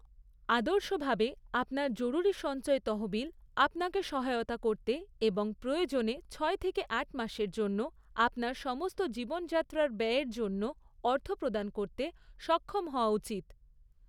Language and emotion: Bengali, neutral